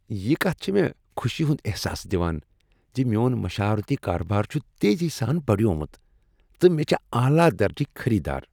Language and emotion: Kashmiri, happy